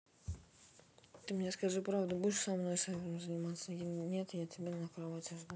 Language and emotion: Russian, neutral